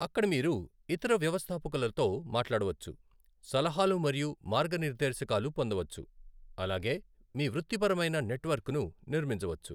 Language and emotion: Telugu, neutral